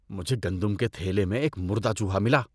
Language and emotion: Urdu, disgusted